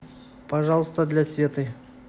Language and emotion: Russian, neutral